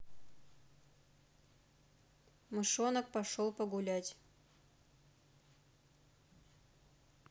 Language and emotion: Russian, neutral